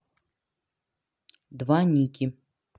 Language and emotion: Russian, neutral